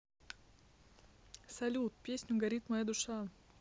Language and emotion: Russian, neutral